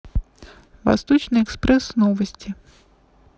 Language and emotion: Russian, neutral